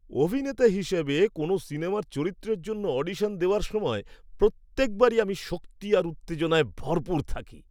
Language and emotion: Bengali, happy